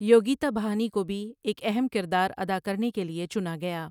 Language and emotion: Urdu, neutral